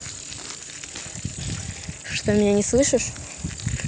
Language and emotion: Russian, neutral